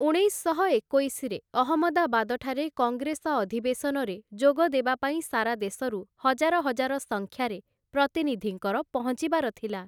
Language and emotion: Odia, neutral